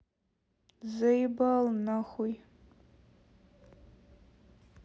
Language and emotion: Russian, sad